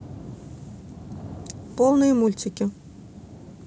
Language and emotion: Russian, neutral